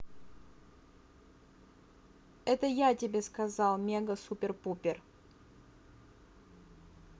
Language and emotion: Russian, neutral